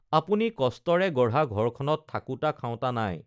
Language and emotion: Assamese, neutral